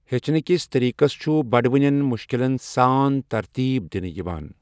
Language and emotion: Kashmiri, neutral